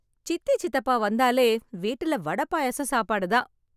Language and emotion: Tamil, happy